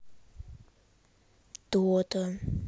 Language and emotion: Russian, neutral